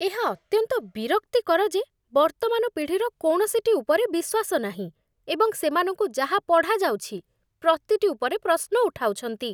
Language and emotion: Odia, disgusted